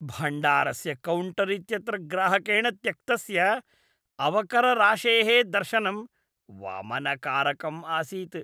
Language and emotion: Sanskrit, disgusted